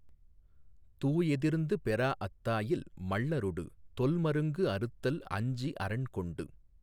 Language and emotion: Tamil, neutral